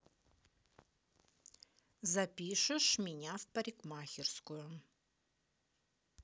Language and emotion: Russian, angry